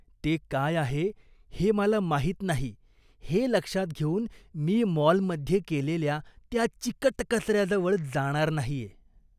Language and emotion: Marathi, disgusted